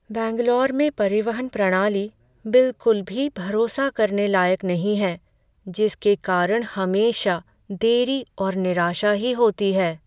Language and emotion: Hindi, sad